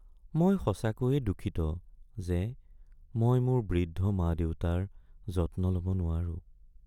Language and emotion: Assamese, sad